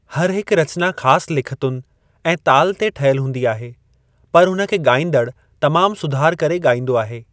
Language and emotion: Sindhi, neutral